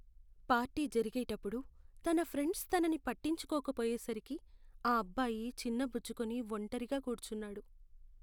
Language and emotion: Telugu, sad